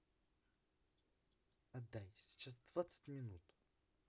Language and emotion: Russian, neutral